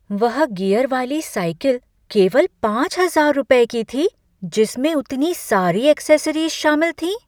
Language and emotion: Hindi, surprised